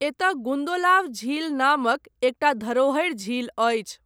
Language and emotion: Maithili, neutral